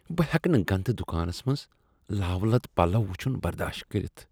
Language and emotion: Kashmiri, disgusted